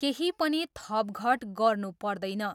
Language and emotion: Nepali, neutral